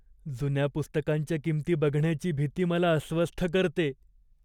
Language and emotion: Marathi, fearful